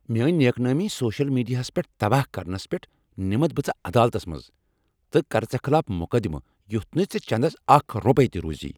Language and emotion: Kashmiri, angry